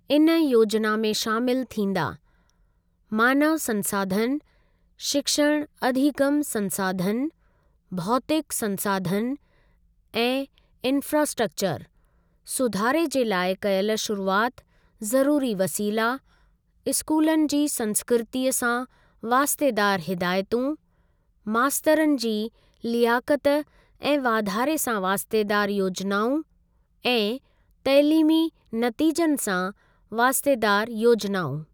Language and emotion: Sindhi, neutral